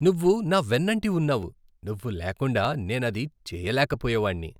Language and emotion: Telugu, happy